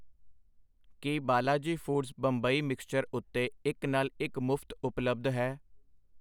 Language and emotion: Punjabi, neutral